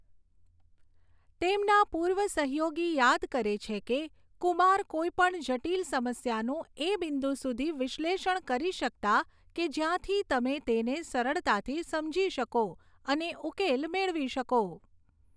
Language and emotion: Gujarati, neutral